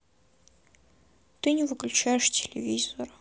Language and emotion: Russian, sad